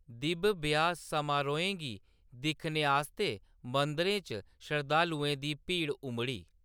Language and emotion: Dogri, neutral